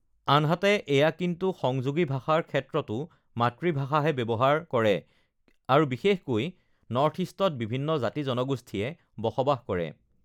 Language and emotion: Assamese, neutral